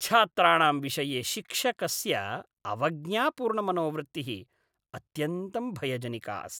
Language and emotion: Sanskrit, disgusted